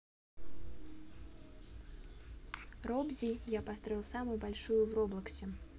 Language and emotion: Russian, neutral